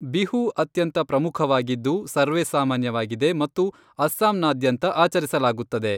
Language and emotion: Kannada, neutral